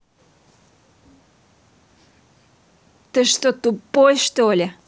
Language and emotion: Russian, angry